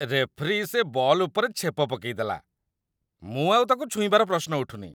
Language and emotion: Odia, disgusted